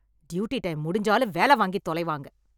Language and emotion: Tamil, angry